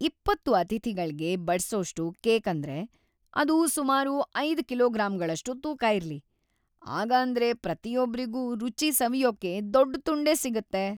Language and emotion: Kannada, happy